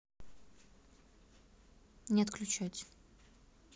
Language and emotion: Russian, neutral